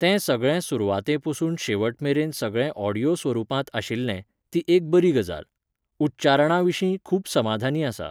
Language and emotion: Goan Konkani, neutral